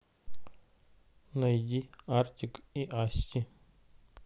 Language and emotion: Russian, neutral